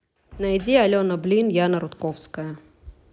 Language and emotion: Russian, neutral